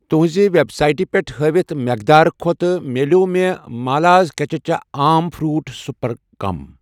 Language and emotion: Kashmiri, neutral